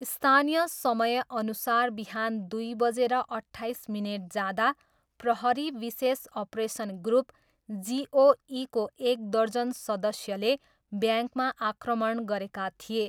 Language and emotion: Nepali, neutral